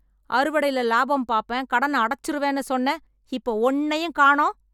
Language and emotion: Tamil, angry